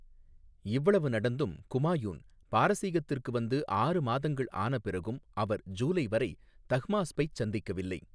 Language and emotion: Tamil, neutral